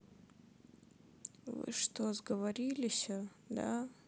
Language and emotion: Russian, sad